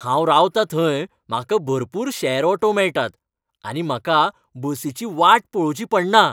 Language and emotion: Goan Konkani, happy